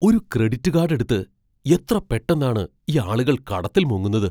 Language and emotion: Malayalam, surprised